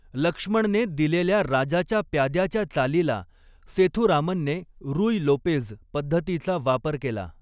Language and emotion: Marathi, neutral